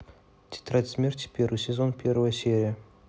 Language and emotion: Russian, neutral